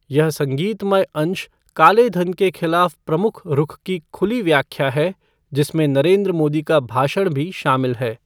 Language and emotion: Hindi, neutral